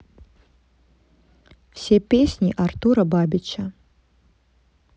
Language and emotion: Russian, neutral